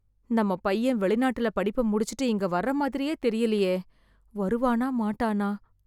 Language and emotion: Tamil, fearful